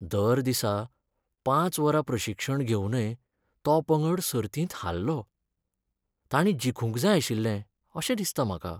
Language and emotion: Goan Konkani, sad